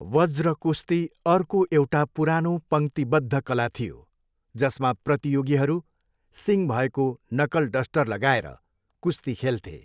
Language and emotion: Nepali, neutral